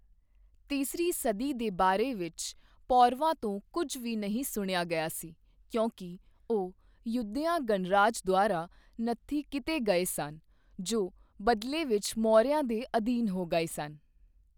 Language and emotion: Punjabi, neutral